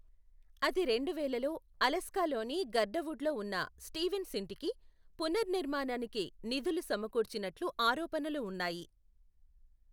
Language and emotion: Telugu, neutral